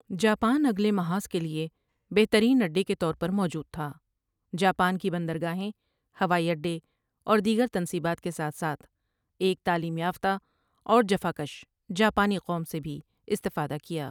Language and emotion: Urdu, neutral